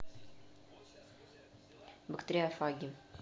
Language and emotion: Russian, neutral